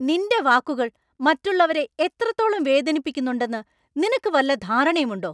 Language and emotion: Malayalam, angry